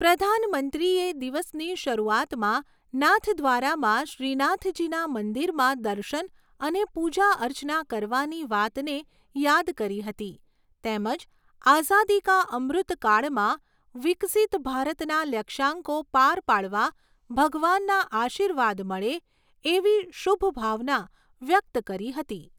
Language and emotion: Gujarati, neutral